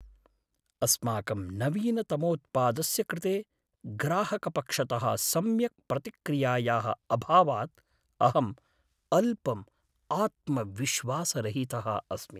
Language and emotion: Sanskrit, sad